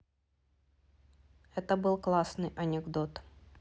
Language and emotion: Russian, neutral